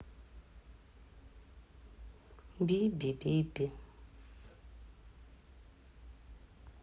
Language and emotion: Russian, sad